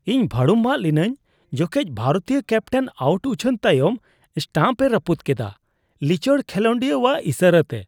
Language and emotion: Santali, disgusted